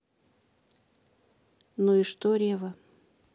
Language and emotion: Russian, neutral